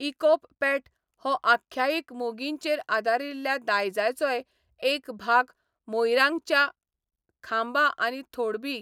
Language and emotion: Goan Konkani, neutral